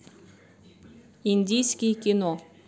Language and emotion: Russian, neutral